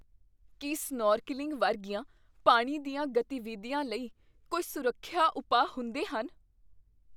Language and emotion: Punjabi, fearful